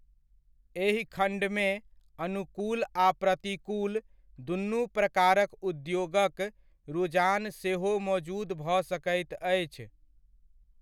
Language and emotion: Maithili, neutral